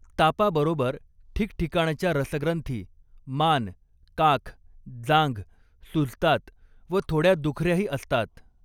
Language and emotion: Marathi, neutral